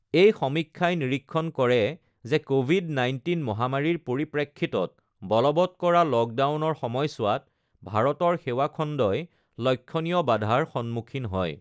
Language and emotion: Assamese, neutral